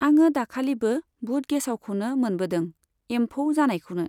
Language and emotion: Bodo, neutral